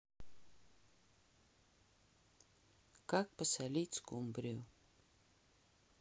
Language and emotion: Russian, neutral